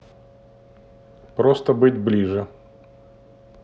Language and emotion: Russian, neutral